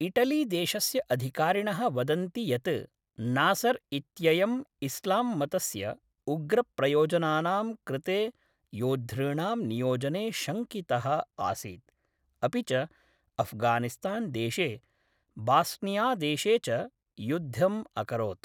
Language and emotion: Sanskrit, neutral